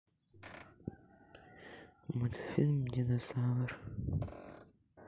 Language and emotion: Russian, sad